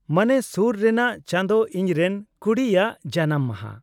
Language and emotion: Santali, neutral